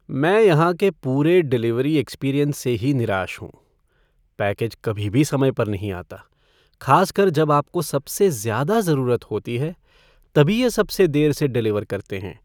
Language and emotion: Hindi, sad